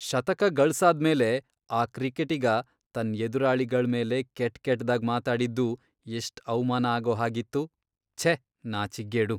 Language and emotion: Kannada, disgusted